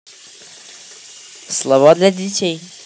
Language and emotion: Russian, positive